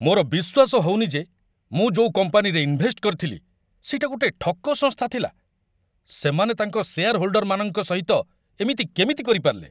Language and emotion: Odia, angry